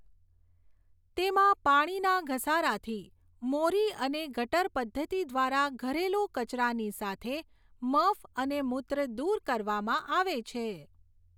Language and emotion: Gujarati, neutral